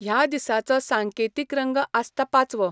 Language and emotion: Goan Konkani, neutral